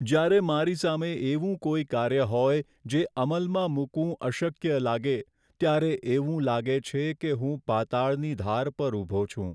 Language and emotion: Gujarati, sad